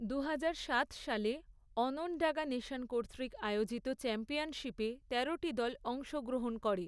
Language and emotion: Bengali, neutral